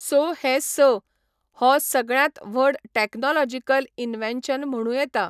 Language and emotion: Goan Konkani, neutral